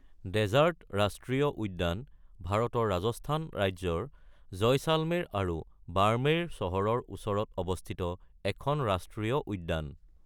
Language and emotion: Assamese, neutral